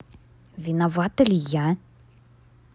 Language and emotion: Russian, neutral